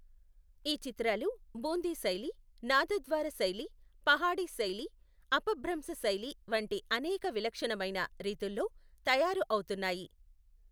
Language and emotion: Telugu, neutral